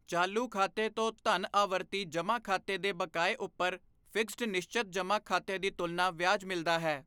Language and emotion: Punjabi, neutral